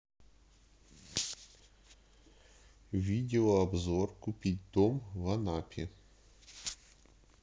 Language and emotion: Russian, neutral